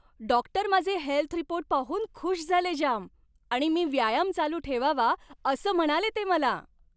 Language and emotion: Marathi, happy